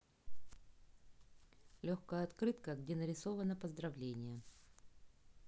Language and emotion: Russian, neutral